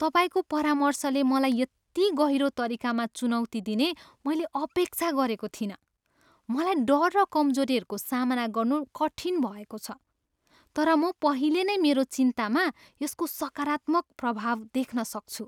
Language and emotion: Nepali, surprised